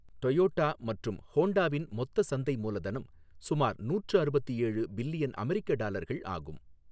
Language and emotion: Tamil, neutral